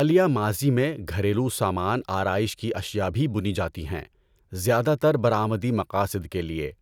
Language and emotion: Urdu, neutral